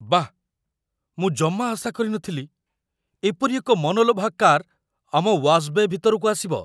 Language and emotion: Odia, surprised